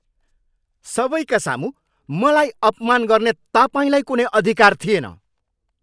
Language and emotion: Nepali, angry